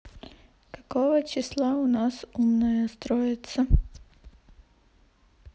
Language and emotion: Russian, neutral